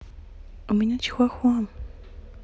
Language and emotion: Russian, neutral